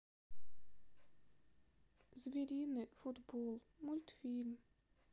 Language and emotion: Russian, sad